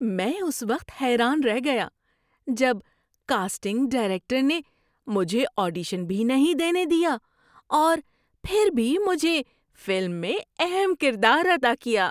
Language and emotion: Urdu, surprised